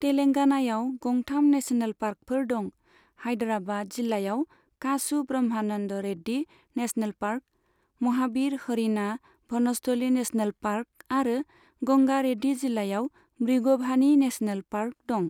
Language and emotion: Bodo, neutral